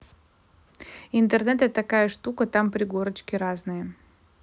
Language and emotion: Russian, neutral